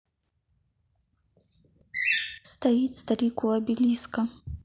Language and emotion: Russian, neutral